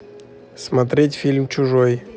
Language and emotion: Russian, neutral